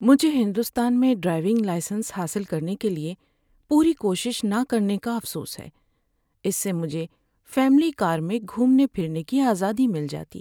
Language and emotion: Urdu, sad